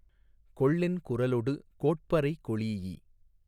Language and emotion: Tamil, neutral